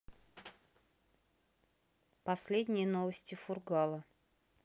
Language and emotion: Russian, neutral